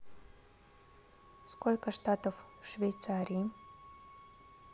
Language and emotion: Russian, neutral